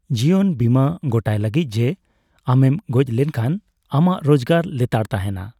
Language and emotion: Santali, neutral